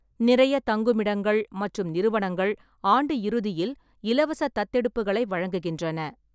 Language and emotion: Tamil, neutral